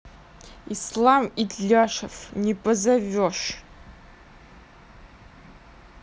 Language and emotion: Russian, angry